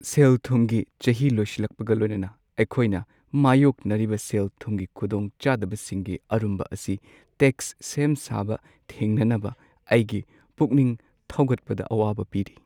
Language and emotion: Manipuri, sad